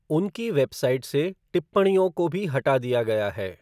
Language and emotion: Hindi, neutral